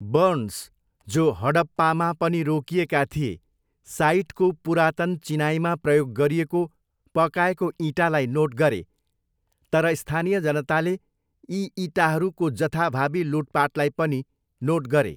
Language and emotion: Nepali, neutral